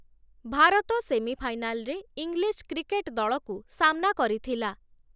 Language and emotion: Odia, neutral